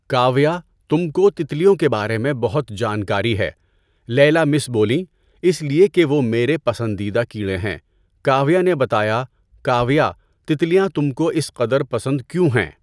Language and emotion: Urdu, neutral